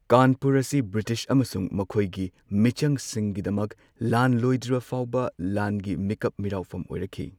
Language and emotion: Manipuri, neutral